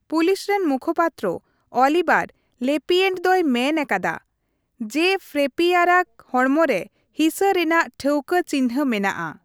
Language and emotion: Santali, neutral